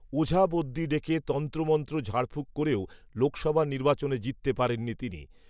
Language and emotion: Bengali, neutral